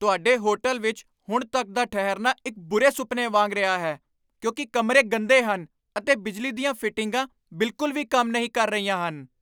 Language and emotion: Punjabi, angry